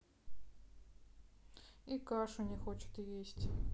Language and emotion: Russian, sad